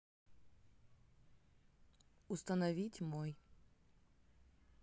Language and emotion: Russian, neutral